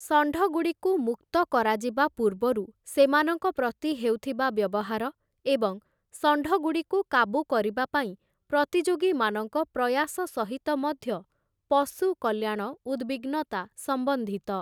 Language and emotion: Odia, neutral